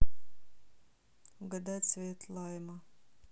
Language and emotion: Russian, neutral